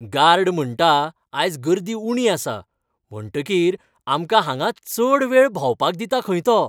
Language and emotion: Goan Konkani, happy